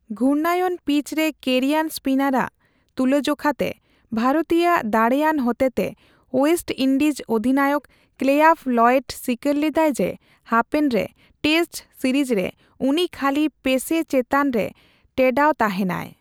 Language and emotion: Santali, neutral